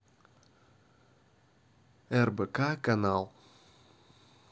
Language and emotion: Russian, neutral